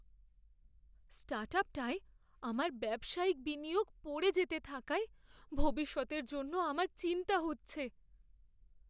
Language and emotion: Bengali, fearful